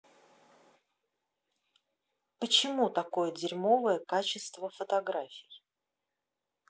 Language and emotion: Russian, angry